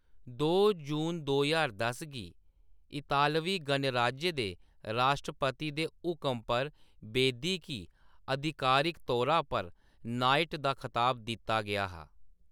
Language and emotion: Dogri, neutral